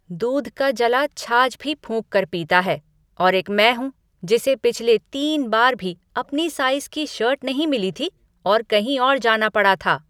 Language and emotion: Hindi, angry